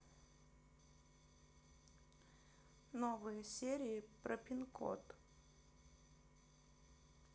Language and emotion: Russian, neutral